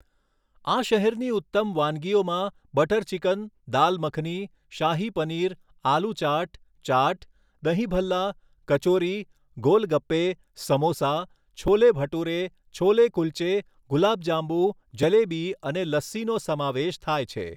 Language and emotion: Gujarati, neutral